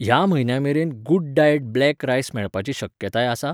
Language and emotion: Goan Konkani, neutral